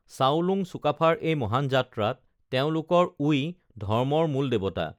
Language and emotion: Assamese, neutral